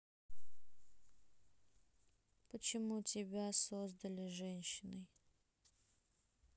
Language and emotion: Russian, neutral